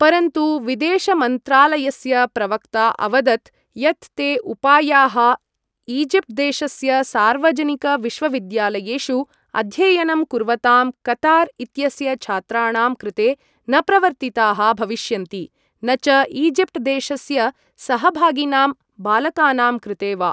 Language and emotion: Sanskrit, neutral